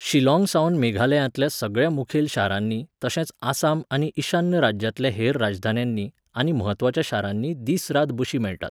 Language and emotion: Goan Konkani, neutral